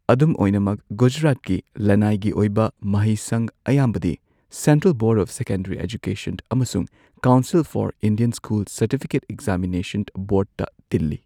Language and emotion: Manipuri, neutral